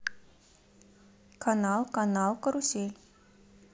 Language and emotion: Russian, neutral